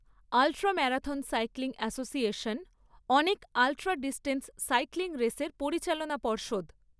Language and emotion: Bengali, neutral